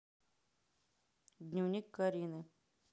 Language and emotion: Russian, neutral